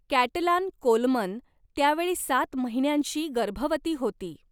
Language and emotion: Marathi, neutral